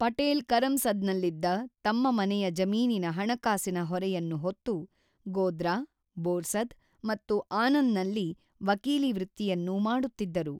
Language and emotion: Kannada, neutral